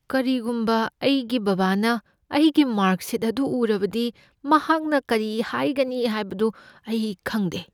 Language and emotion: Manipuri, fearful